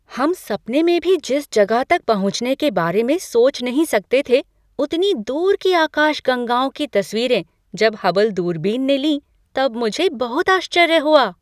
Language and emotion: Hindi, surprised